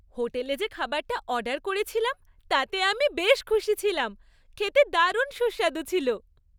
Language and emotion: Bengali, happy